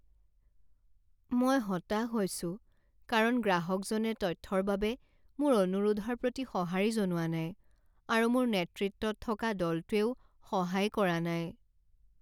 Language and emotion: Assamese, sad